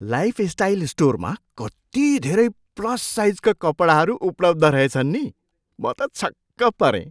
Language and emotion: Nepali, surprised